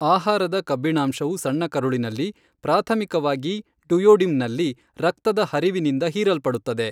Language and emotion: Kannada, neutral